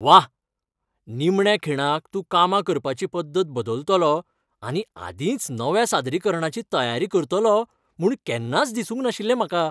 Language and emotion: Goan Konkani, happy